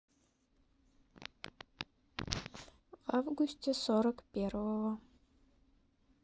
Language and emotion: Russian, sad